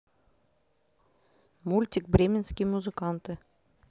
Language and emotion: Russian, neutral